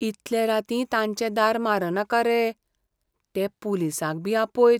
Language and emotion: Goan Konkani, fearful